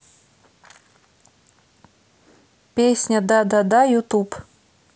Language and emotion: Russian, neutral